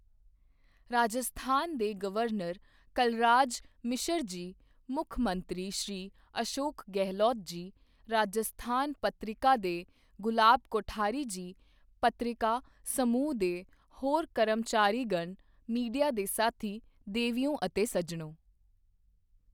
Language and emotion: Punjabi, neutral